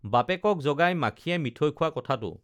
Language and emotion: Assamese, neutral